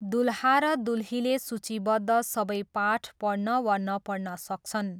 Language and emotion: Nepali, neutral